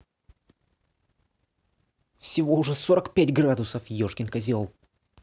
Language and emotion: Russian, angry